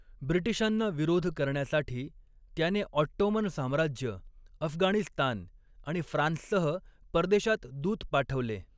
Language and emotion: Marathi, neutral